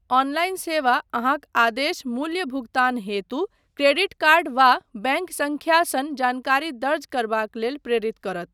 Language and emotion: Maithili, neutral